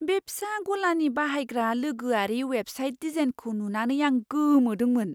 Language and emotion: Bodo, surprised